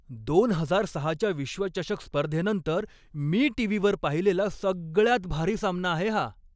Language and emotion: Marathi, happy